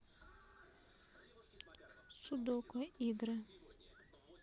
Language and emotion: Russian, neutral